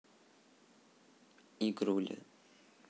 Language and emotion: Russian, neutral